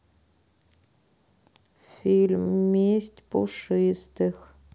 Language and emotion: Russian, sad